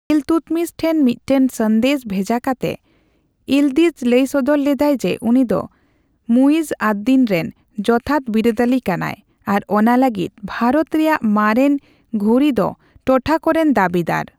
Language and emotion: Santali, neutral